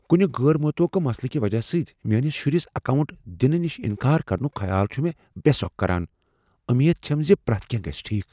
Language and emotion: Kashmiri, fearful